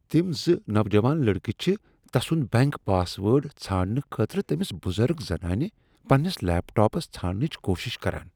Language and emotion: Kashmiri, disgusted